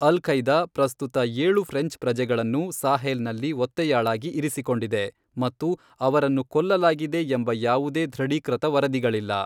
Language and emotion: Kannada, neutral